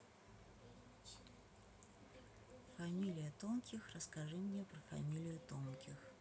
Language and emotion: Russian, neutral